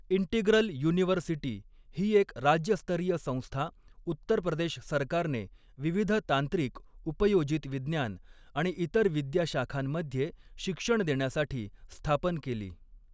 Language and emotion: Marathi, neutral